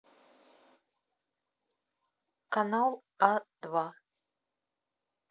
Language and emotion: Russian, neutral